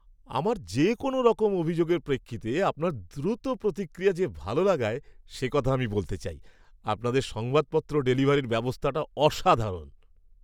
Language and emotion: Bengali, happy